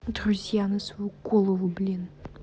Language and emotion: Russian, angry